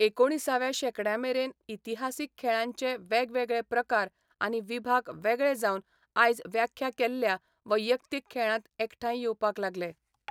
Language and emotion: Goan Konkani, neutral